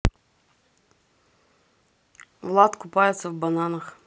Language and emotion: Russian, neutral